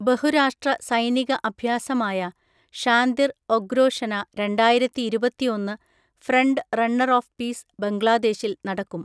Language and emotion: Malayalam, neutral